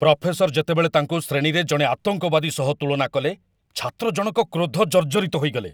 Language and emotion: Odia, angry